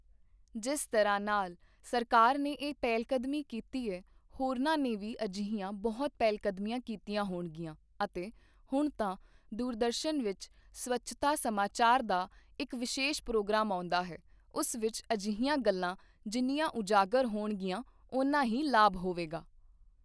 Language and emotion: Punjabi, neutral